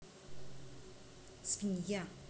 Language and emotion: Russian, neutral